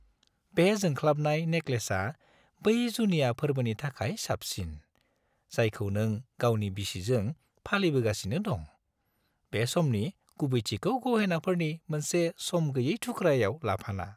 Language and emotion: Bodo, happy